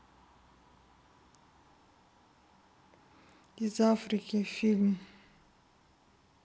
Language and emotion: Russian, neutral